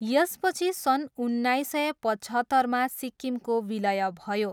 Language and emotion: Nepali, neutral